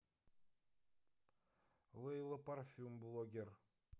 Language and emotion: Russian, neutral